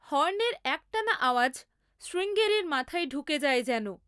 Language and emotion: Bengali, neutral